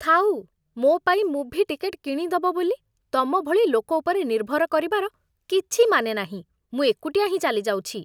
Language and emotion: Odia, disgusted